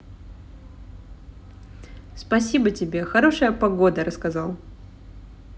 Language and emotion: Russian, positive